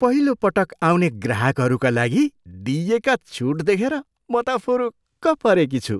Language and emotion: Nepali, surprised